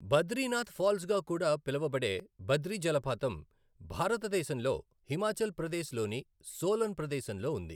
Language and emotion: Telugu, neutral